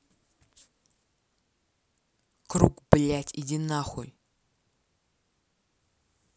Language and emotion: Russian, angry